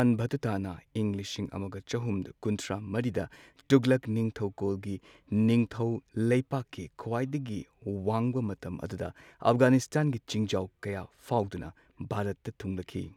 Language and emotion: Manipuri, neutral